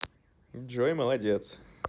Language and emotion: Russian, positive